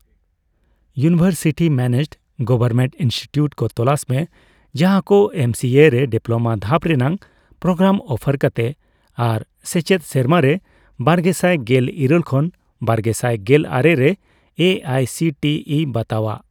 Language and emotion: Santali, neutral